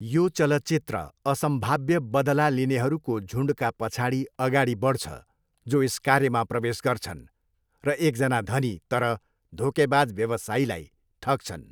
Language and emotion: Nepali, neutral